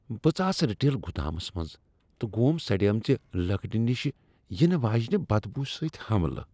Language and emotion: Kashmiri, disgusted